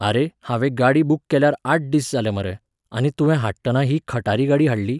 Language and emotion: Goan Konkani, neutral